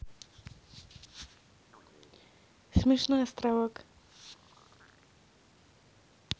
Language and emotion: Russian, neutral